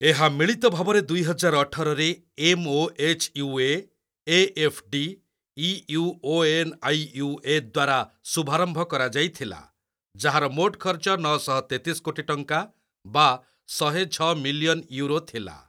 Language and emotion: Odia, neutral